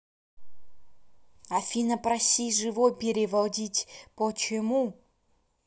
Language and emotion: Russian, neutral